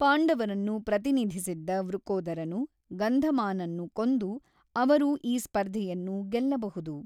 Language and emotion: Kannada, neutral